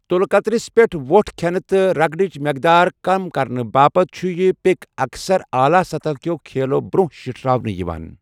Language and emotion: Kashmiri, neutral